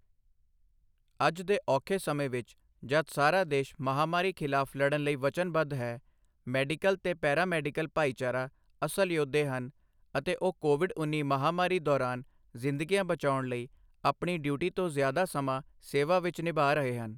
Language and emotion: Punjabi, neutral